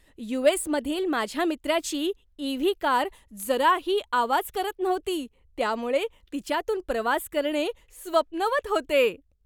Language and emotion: Marathi, happy